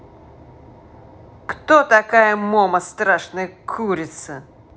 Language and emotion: Russian, angry